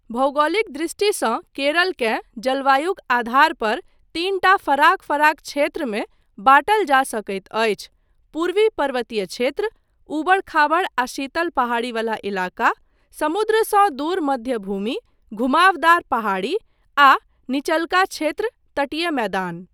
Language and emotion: Maithili, neutral